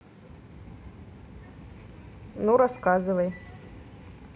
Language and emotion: Russian, neutral